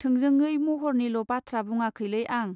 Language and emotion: Bodo, neutral